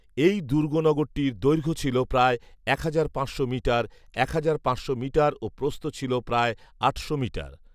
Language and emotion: Bengali, neutral